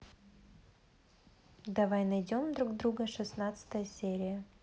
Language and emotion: Russian, neutral